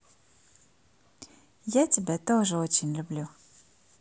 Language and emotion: Russian, positive